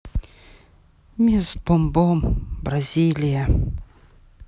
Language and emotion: Russian, sad